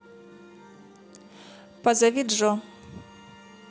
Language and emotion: Russian, neutral